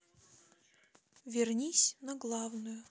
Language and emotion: Russian, neutral